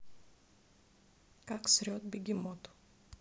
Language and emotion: Russian, neutral